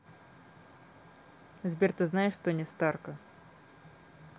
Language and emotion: Russian, neutral